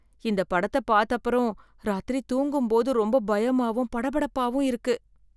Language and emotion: Tamil, fearful